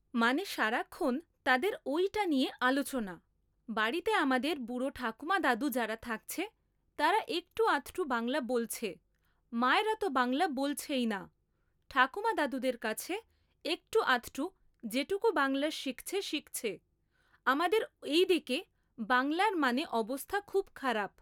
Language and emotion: Bengali, neutral